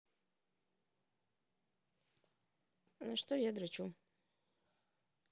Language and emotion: Russian, neutral